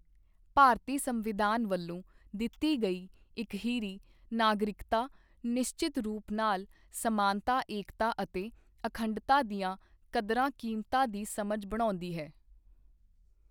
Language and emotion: Punjabi, neutral